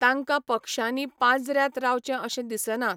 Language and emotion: Goan Konkani, neutral